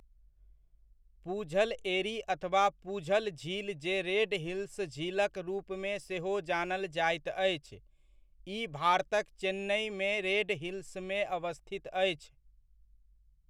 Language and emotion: Maithili, neutral